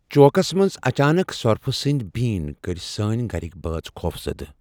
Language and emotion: Kashmiri, fearful